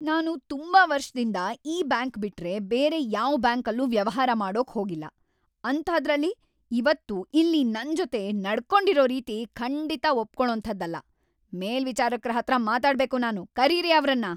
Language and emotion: Kannada, angry